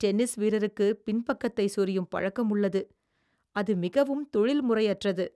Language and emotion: Tamil, disgusted